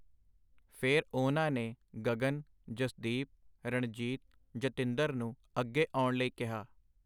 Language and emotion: Punjabi, neutral